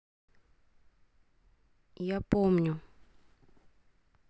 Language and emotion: Russian, neutral